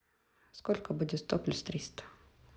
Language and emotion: Russian, neutral